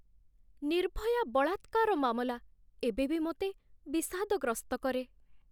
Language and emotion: Odia, sad